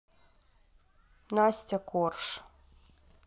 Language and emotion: Russian, neutral